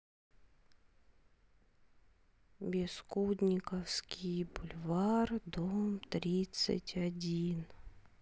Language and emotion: Russian, sad